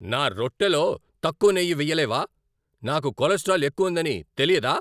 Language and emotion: Telugu, angry